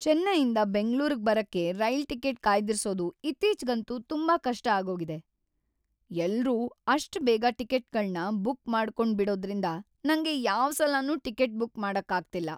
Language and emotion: Kannada, sad